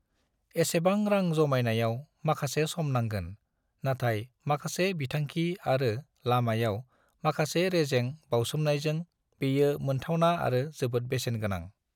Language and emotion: Bodo, neutral